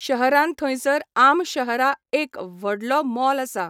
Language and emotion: Goan Konkani, neutral